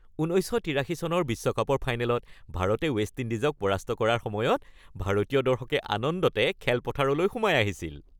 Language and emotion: Assamese, happy